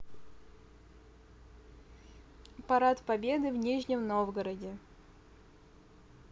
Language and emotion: Russian, neutral